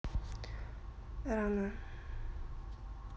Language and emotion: Russian, neutral